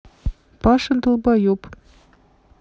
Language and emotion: Russian, neutral